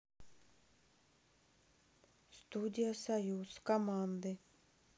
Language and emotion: Russian, neutral